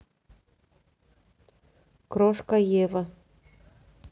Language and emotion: Russian, neutral